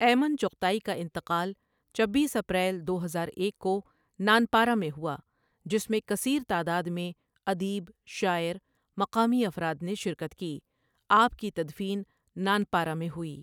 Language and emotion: Urdu, neutral